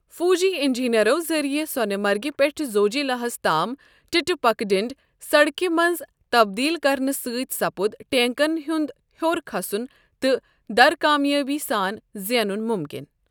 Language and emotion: Kashmiri, neutral